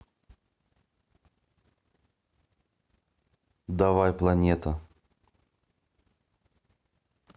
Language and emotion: Russian, neutral